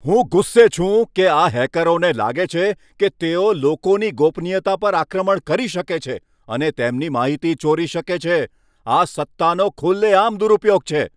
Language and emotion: Gujarati, angry